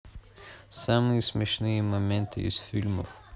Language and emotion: Russian, neutral